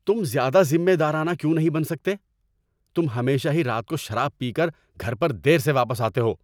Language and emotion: Urdu, angry